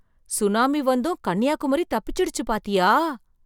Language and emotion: Tamil, surprised